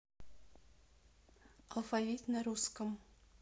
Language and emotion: Russian, neutral